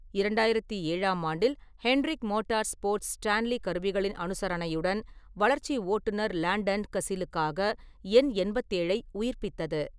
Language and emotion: Tamil, neutral